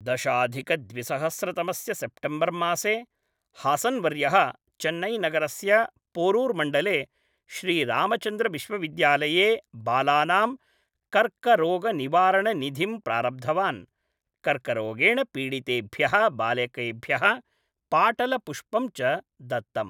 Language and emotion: Sanskrit, neutral